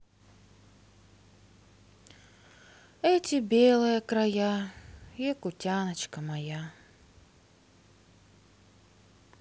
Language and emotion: Russian, sad